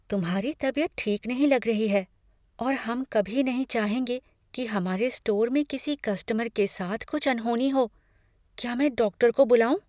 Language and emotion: Hindi, fearful